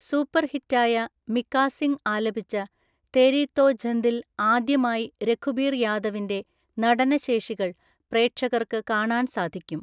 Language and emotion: Malayalam, neutral